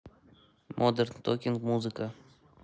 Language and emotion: Russian, neutral